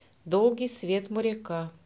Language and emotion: Russian, neutral